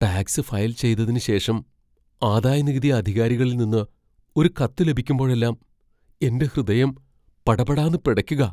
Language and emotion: Malayalam, fearful